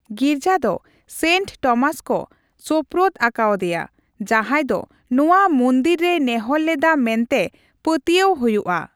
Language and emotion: Santali, neutral